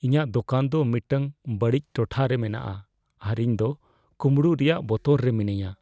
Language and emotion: Santali, fearful